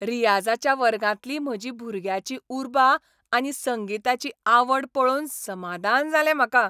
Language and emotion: Goan Konkani, happy